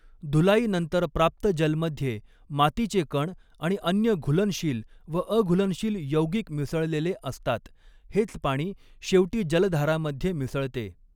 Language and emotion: Marathi, neutral